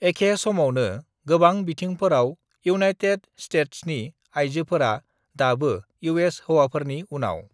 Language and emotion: Bodo, neutral